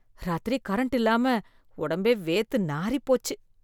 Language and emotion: Tamil, disgusted